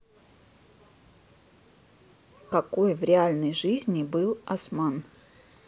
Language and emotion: Russian, neutral